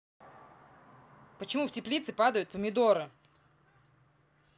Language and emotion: Russian, angry